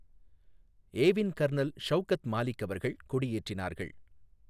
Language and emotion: Tamil, neutral